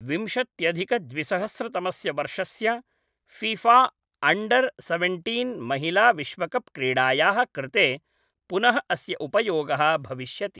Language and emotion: Sanskrit, neutral